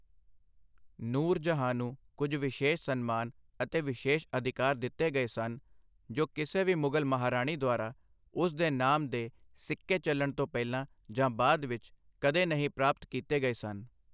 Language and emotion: Punjabi, neutral